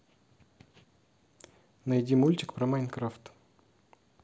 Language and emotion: Russian, neutral